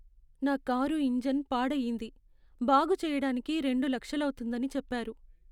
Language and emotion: Telugu, sad